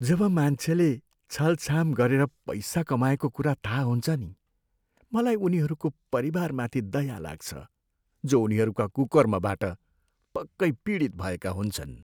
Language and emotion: Nepali, sad